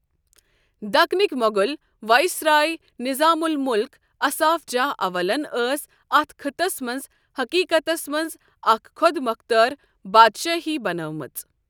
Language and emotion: Kashmiri, neutral